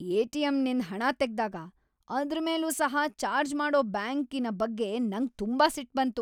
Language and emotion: Kannada, angry